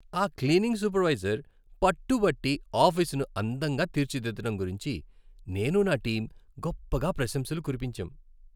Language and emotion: Telugu, happy